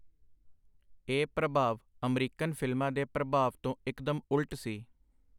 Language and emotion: Punjabi, neutral